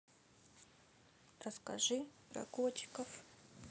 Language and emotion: Russian, sad